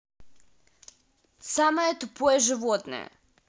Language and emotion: Russian, angry